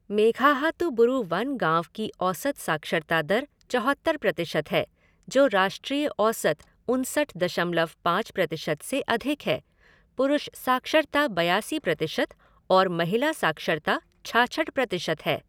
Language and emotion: Hindi, neutral